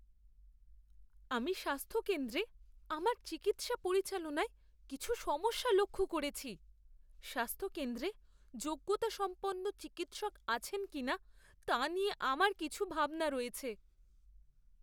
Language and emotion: Bengali, fearful